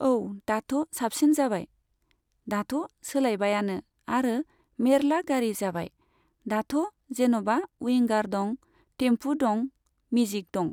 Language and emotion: Bodo, neutral